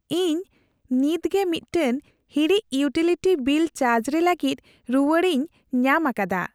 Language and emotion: Santali, happy